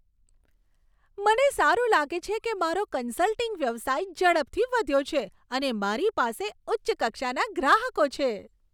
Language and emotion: Gujarati, happy